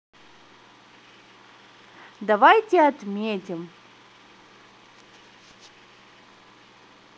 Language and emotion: Russian, positive